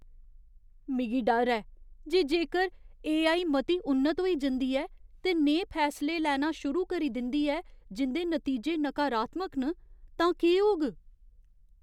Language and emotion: Dogri, fearful